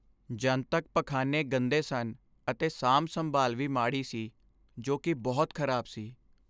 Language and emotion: Punjabi, sad